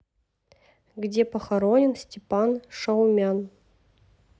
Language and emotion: Russian, neutral